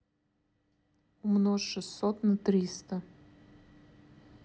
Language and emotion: Russian, neutral